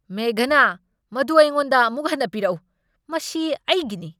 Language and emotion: Manipuri, angry